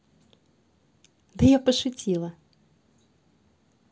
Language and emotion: Russian, positive